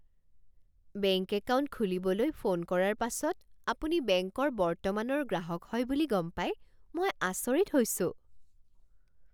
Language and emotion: Assamese, surprised